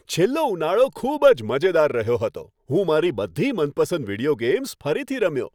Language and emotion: Gujarati, happy